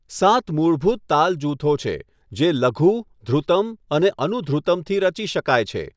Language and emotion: Gujarati, neutral